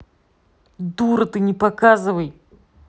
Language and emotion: Russian, angry